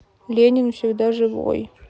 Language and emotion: Russian, sad